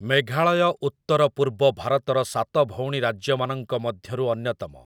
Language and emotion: Odia, neutral